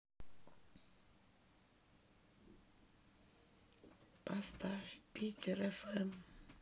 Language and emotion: Russian, sad